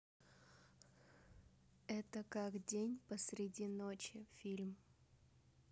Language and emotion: Russian, neutral